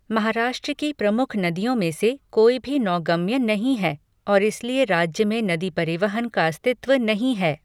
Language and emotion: Hindi, neutral